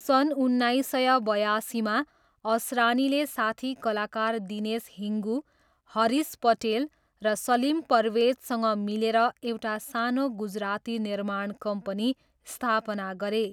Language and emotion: Nepali, neutral